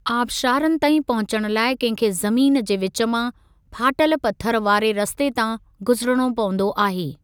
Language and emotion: Sindhi, neutral